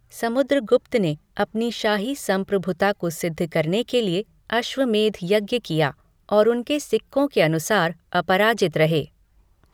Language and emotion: Hindi, neutral